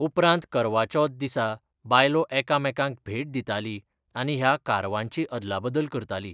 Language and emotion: Goan Konkani, neutral